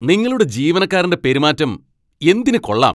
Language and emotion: Malayalam, angry